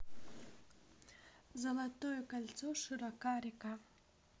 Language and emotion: Russian, neutral